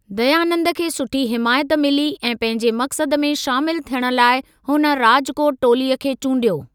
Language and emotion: Sindhi, neutral